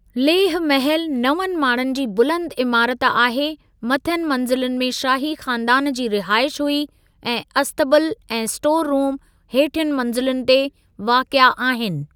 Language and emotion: Sindhi, neutral